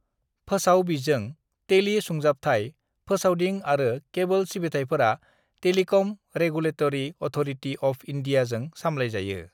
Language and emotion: Bodo, neutral